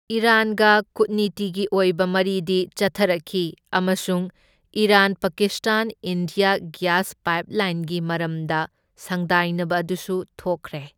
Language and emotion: Manipuri, neutral